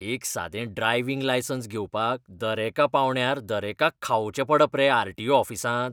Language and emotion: Goan Konkani, disgusted